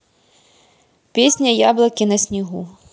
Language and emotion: Russian, neutral